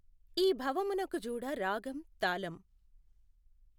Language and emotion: Telugu, neutral